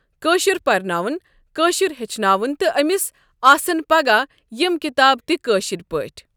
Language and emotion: Kashmiri, neutral